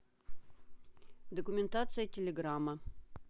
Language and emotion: Russian, neutral